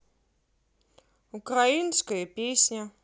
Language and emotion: Russian, neutral